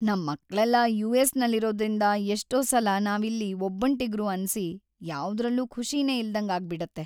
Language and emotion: Kannada, sad